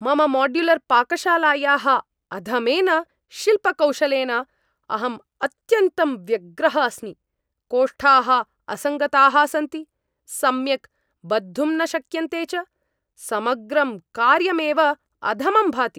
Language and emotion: Sanskrit, angry